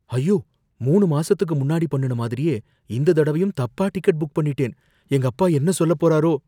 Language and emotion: Tamil, fearful